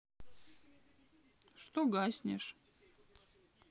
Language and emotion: Russian, sad